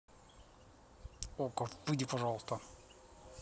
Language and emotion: Russian, neutral